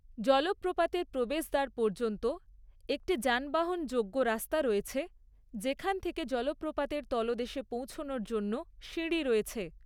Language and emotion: Bengali, neutral